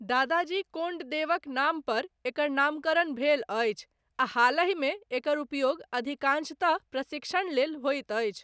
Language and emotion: Maithili, neutral